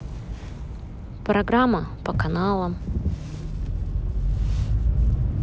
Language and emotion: Russian, neutral